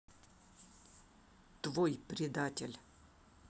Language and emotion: Russian, angry